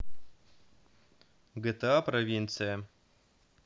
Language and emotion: Russian, neutral